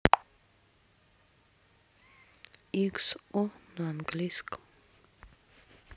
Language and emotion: Russian, sad